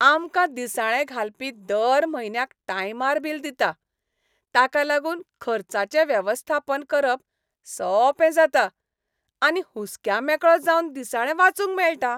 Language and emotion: Goan Konkani, happy